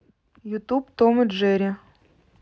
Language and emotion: Russian, neutral